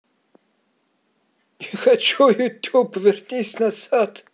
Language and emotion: Russian, positive